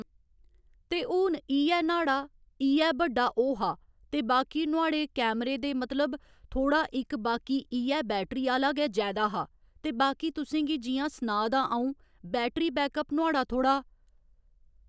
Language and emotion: Dogri, neutral